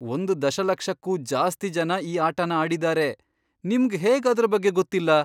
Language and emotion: Kannada, surprised